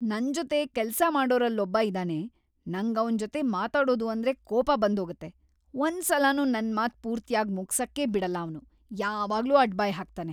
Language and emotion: Kannada, angry